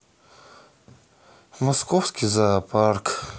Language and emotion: Russian, sad